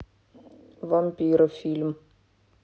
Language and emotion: Russian, neutral